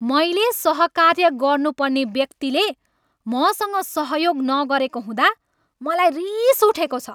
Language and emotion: Nepali, angry